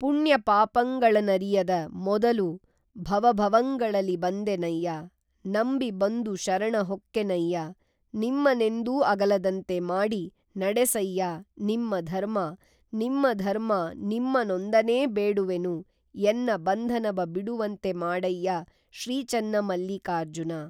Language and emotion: Kannada, neutral